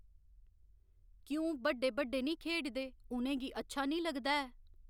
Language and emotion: Dogri, neutral